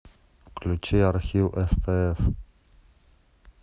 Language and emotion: Russian, neutral